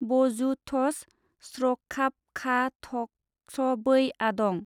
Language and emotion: Bodo, neutral